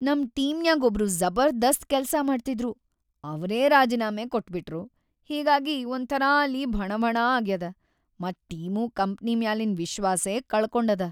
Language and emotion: Kannada, sad